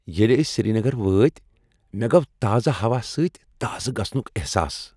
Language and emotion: Kashmiri, happy